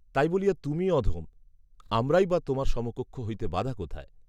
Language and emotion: Bengali, neutral